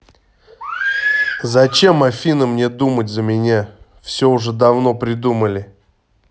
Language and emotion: Russian, angry